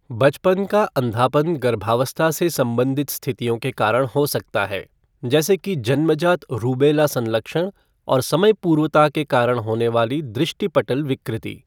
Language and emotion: Hindi, neutral